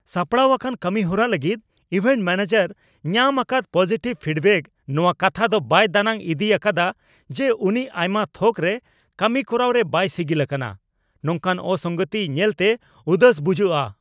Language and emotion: Santali, angry